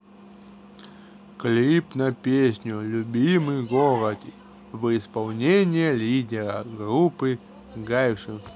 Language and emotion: Russian, neutral